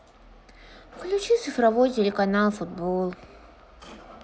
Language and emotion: Russian, sad